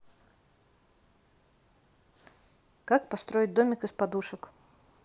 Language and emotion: Russian, neutral